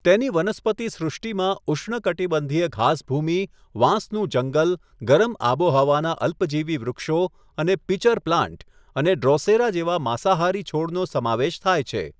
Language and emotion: Gujarati, neutral